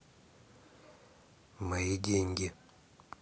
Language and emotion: Russian, neutral